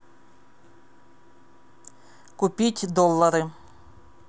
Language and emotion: Russian, neutral